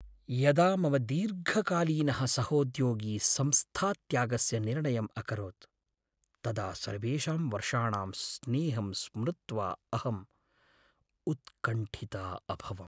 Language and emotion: Sanskrit, sad